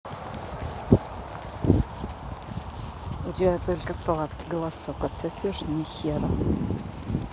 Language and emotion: Russian, angry